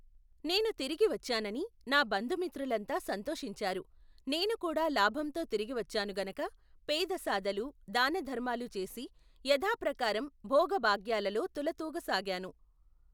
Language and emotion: Telugu, neutral